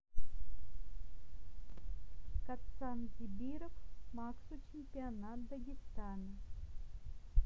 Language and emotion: Russian, neutral